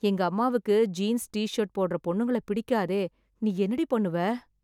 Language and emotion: Tamil, sad